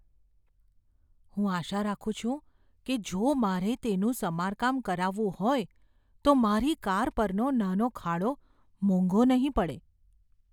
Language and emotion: Gujarati, fearful